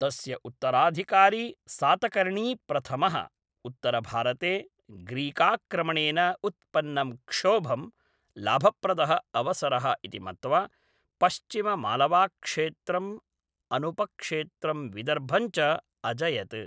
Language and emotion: Sanskrit, neutral